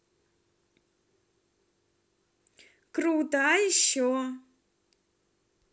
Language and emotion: Russian, positive